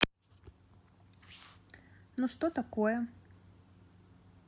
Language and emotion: Russian, neutral